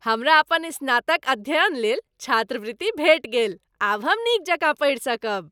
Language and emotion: Maithili, happy